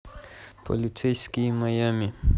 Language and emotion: Russian, neutral